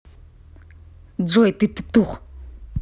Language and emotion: Russian, angry